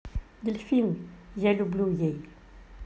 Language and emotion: Russian, neutral